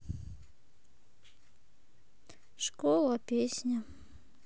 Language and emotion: Russian, sad